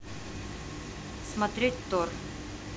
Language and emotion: Russian, neutral